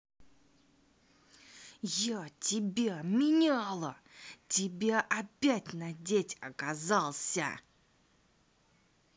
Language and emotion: Russian, angry